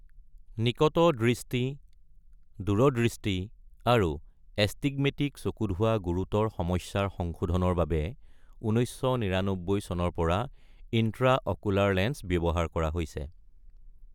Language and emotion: Assamese, neutral